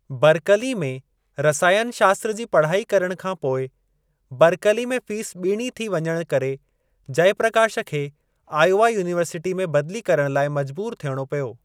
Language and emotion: Sindhi, neutral